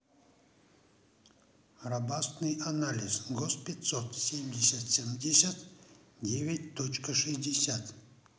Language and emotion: Russian, neutral